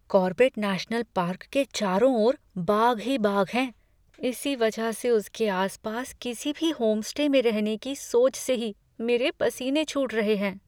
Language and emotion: Hindi, fearful